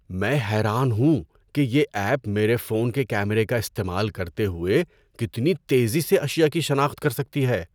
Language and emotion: Urdu, surprised